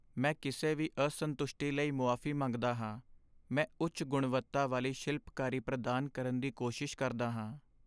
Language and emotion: Punjabi, sad